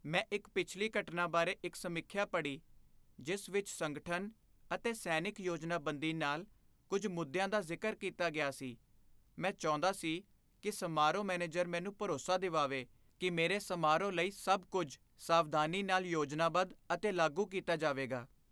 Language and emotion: Punjabi, fearful